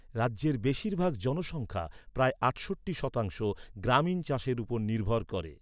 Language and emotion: Bengali, neutral